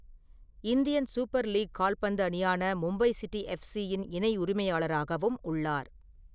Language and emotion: Tamil, neutral